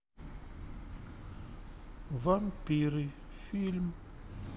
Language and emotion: Russian, neutral